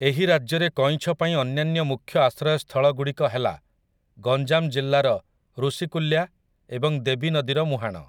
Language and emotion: Odia, neutral